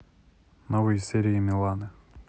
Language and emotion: Russian, neutral